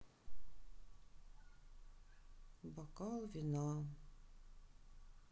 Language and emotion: Russian, sad